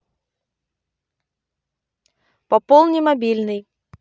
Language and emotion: Russian, neutral